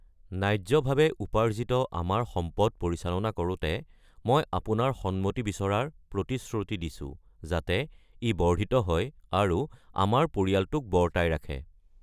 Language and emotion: Assamese, neutral